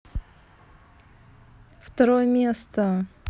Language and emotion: Russian, neutral